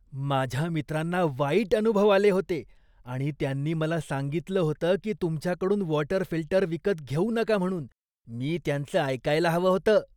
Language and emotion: Marathi, disgusted